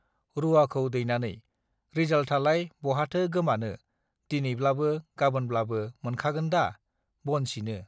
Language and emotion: Bodo, neutral